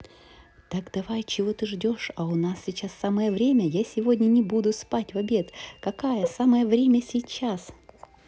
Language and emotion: Russian, neutral